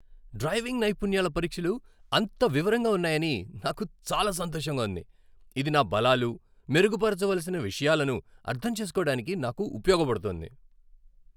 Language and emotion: Telugu, happy